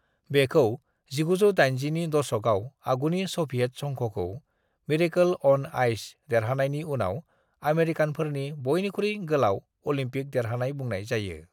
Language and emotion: Bodo, neutral